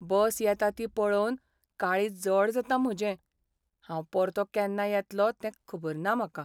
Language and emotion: Goan Konkani, sad